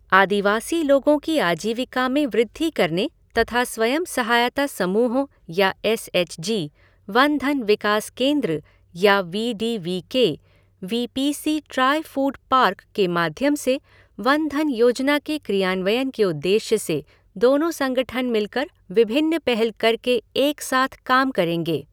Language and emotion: Hindi, neutral